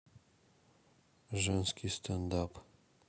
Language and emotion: Russian, neutral